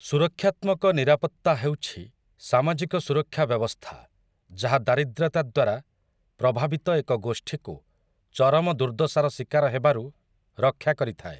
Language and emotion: Odia, neutral